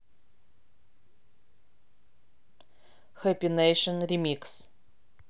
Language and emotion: Russian, neutral